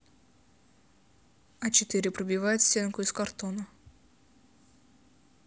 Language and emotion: Russian, neutral